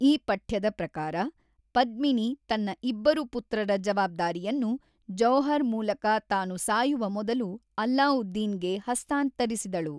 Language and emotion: Kannada, neutral